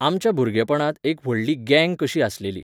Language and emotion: Goan Konkani, neutral